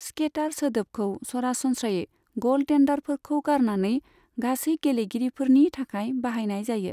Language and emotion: Bodo, neutral